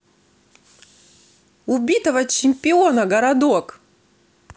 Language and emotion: Russian, neutral